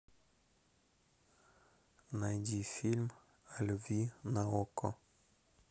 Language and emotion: Russian, neutral